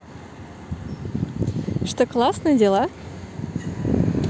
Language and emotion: Russian, positive